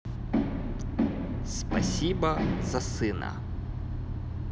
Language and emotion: Russian, neutral